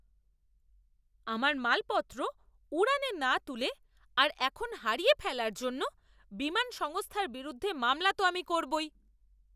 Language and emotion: Bengali, angry